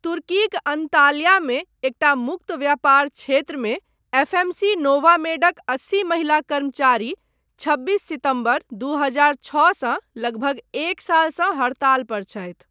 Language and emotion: Maithili, neutral